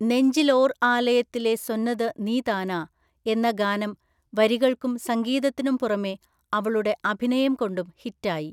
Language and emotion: Malayalam, neutral